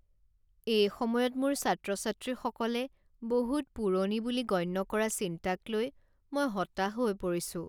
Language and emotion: Assamese, sad